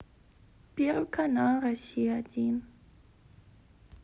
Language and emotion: Russian, sad